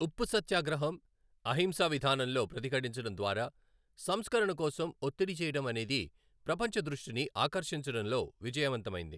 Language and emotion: Telugu, neutral